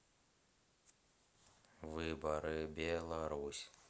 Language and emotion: Russian, neutral